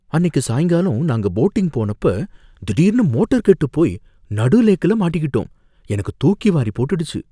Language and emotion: Tamil, fearful